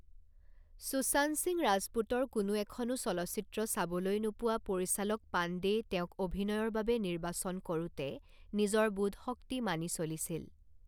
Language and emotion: Assamese, neutral